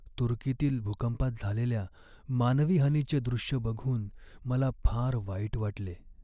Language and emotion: Marathi, sad